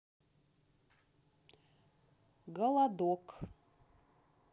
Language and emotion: Russian, neutral